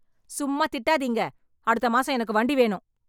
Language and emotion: Tamil, angry